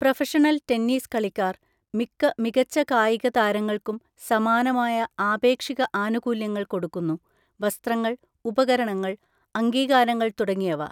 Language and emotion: Malayalam, neutral